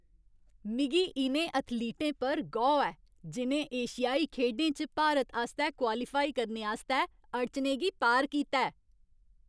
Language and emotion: Dogri, happy